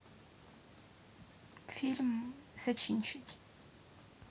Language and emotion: Russian, neutral